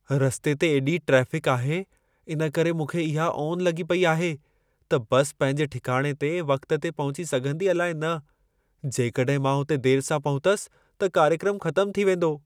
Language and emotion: Sindhi, fearful